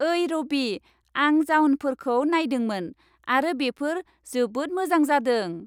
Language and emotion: Bodo, happy